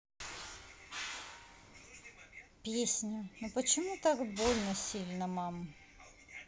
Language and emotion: Russian, sad